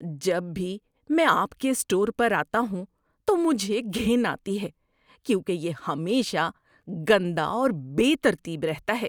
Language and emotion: Urdu, disgusted